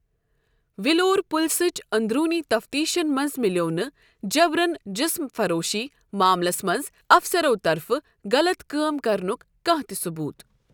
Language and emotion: Kashmiri, neutral